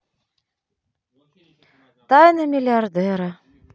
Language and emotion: Russian, neutral